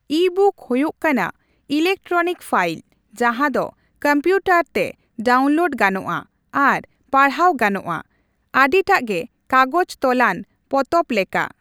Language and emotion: Santali, neutral